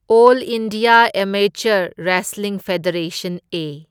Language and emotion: Manipuri, neutral